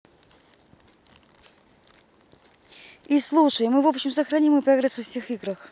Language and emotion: Russian, neutral